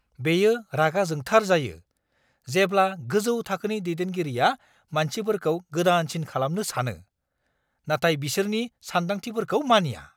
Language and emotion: Bodo, angry